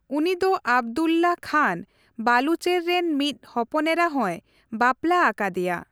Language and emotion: Santali, neutral